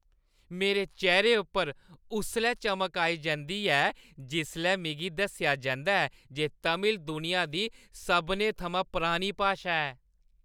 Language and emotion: Dogri, happy